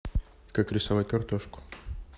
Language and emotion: Russian, neutral